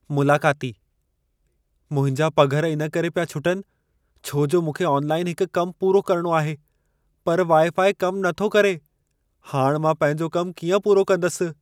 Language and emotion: Sindhi, fearful